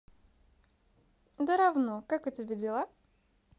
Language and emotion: Russian, positive